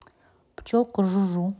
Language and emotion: Russian, neutral